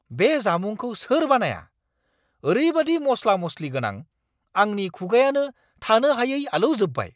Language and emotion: Bodo, angry